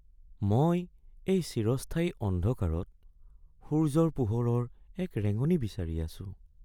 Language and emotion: Assamese, sad